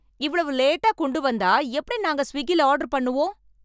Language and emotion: Tamil, angry